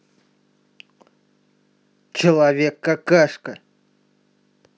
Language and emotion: Russian, angry